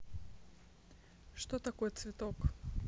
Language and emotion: Russian, neutral